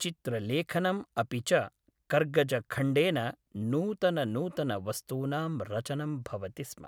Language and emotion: Sanskrit, neutral